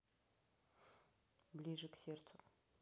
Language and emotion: Russian, neutral